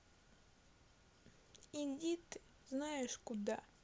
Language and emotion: Russian, sad